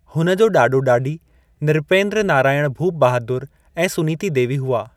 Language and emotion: Sindhi, neutral